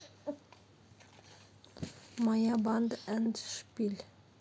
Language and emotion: Russian, neutral